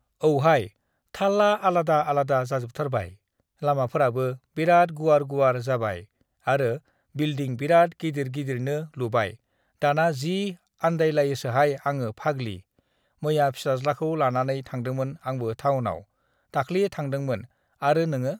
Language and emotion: Bodo, neutral